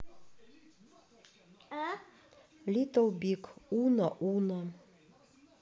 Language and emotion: Russian, neutral